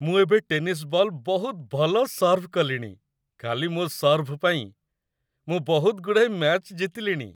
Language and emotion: Odia, happy